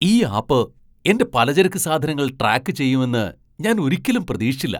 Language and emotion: Malayalam, surprised